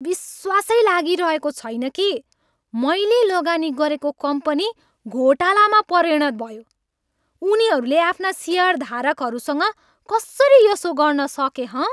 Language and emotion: Nepali, angry